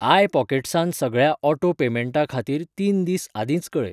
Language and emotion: Goan Konkani, neutral